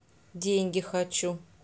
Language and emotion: Russian, neutral